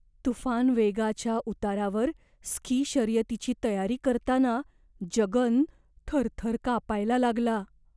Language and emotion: Marathi, fearful